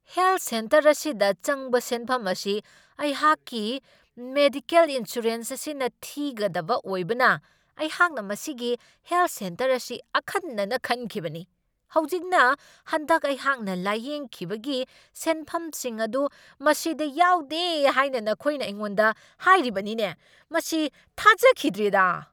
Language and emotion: Manipuri, angry